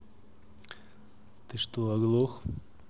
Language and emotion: Russian, neutral